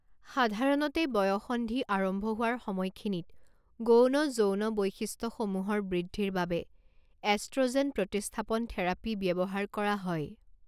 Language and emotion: Assamese, neutral